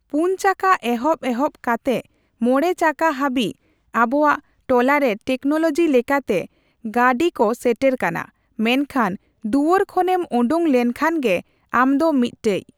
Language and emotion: Santali, neutral